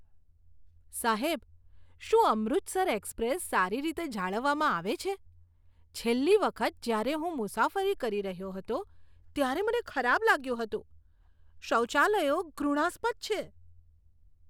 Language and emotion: Gujarati, disgusted